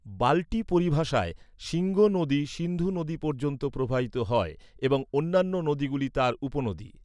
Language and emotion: Bengali, neutral